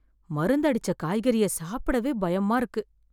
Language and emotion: Tamil, fearful